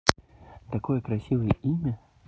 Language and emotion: Russian, positive